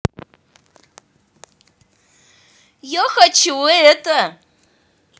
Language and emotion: Russian, neutral